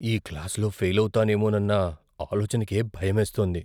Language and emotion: Telugu, fearful